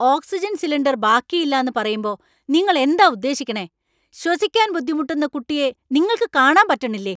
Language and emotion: Malayalam, angry